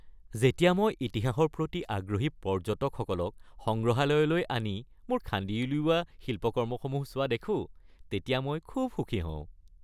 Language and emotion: Assamese, happy